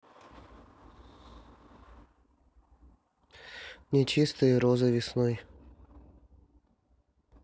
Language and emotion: Russian, neutral